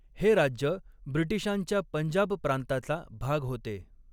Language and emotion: Marathi, neutral